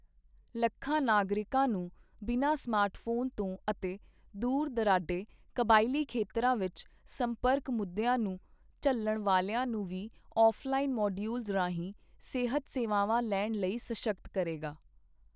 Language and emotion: Punjabi, neutral